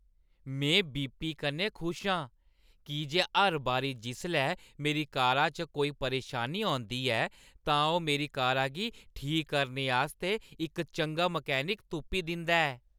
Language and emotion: Dogri, happy